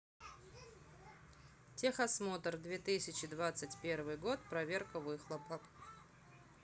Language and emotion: Russian, neutral